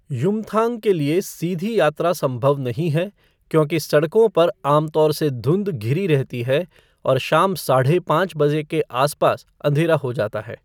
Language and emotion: Hindi, neutral